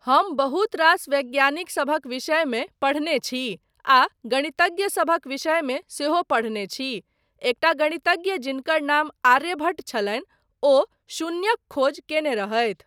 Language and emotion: Maithili, neutral